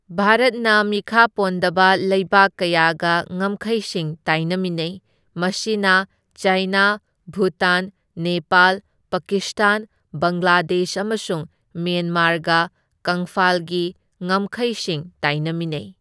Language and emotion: Manipuri, neutral